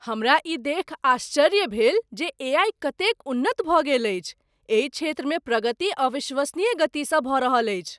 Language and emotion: Maithili, surprised